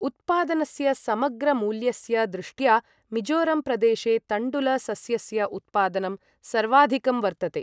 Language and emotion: Sanskrit, neutral